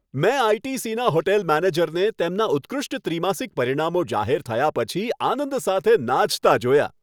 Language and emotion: Gujarati, happy